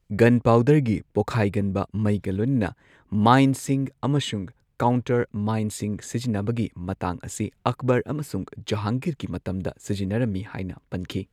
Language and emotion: Manipuri, neutral